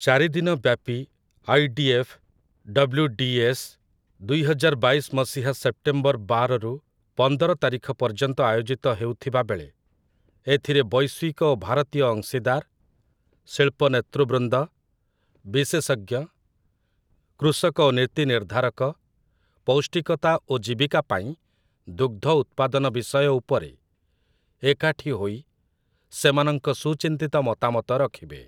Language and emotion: Odia, neutral